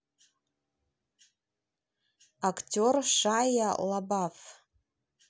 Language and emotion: Russian, neutral